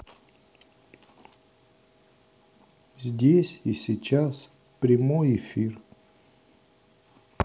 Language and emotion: Russian, sad